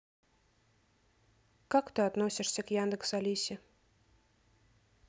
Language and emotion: Russian, neutral